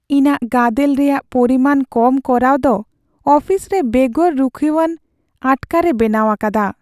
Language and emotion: Santali, sad